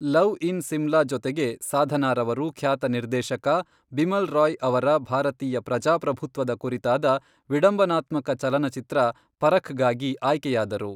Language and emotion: Kannada, neutral